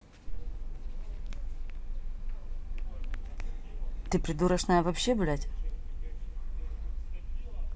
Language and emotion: Russian, angry